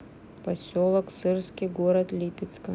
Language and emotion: Russian, neutral